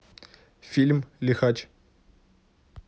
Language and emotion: Russian, neutral